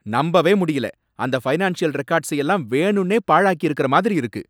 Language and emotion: Tamil, angry